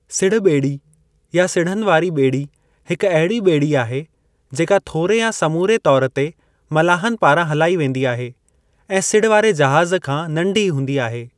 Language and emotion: Sindhi, neutral